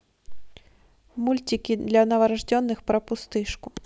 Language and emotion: Russian, neutral